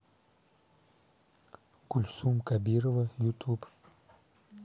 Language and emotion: Russian, neutral